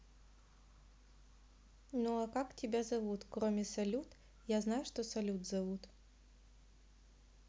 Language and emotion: Russian, neutral